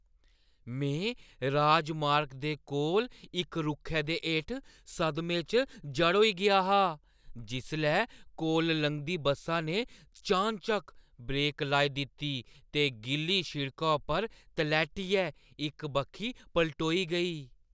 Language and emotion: Dogri, surprised